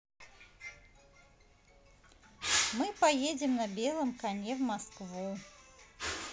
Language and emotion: Russian, positive